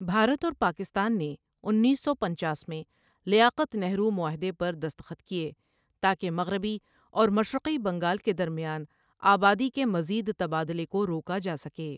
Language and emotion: Urdu, neutral